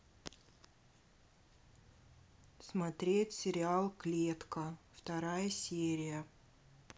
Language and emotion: Russian, neutral